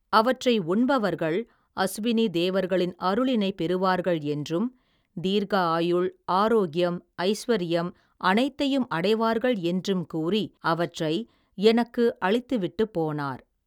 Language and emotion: Tamil, neutral